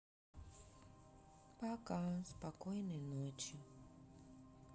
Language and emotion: Russian, sad